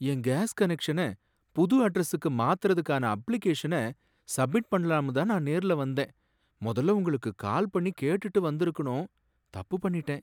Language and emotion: Tamil, sad